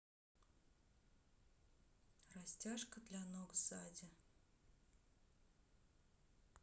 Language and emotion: Russian, neutral